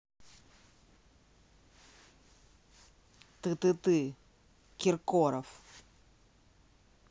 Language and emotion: Russian, neutral